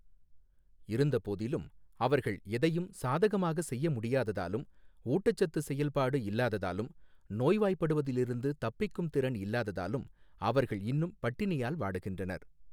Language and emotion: Tamil, neutral